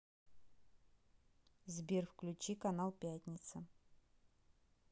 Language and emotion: Russian, neutral